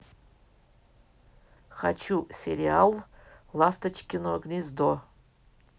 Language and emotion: Russian, neutral